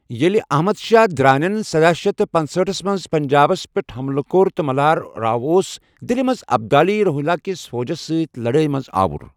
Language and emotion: Kashmiri, neutral